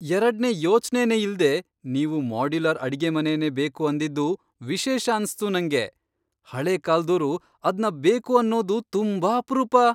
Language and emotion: Kannada, surprised